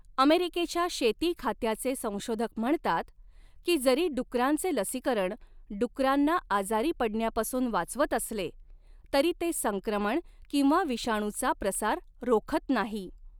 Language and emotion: Marathi, neutral